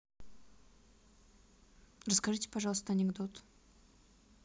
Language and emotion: Russian, neutral